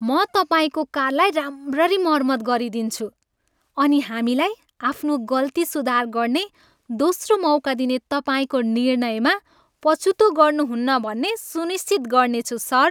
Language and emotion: Nepali, happy